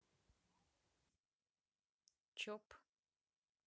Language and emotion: Russian, neutral